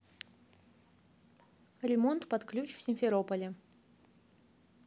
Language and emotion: Russian, neutral